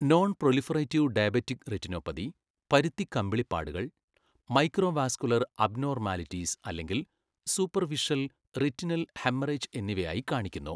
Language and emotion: Malayalam, neutral